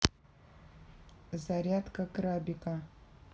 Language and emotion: Russian, neutral